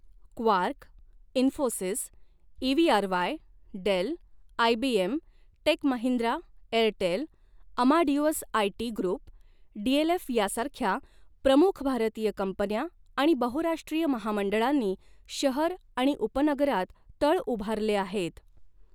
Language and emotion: Marathi, neutral